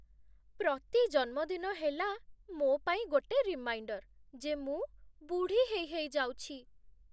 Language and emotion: Odia, sad